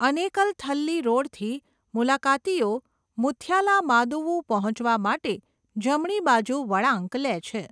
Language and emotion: Gujarati, neutral